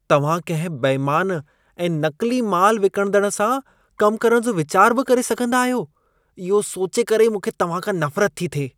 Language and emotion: Sindhi, disgusted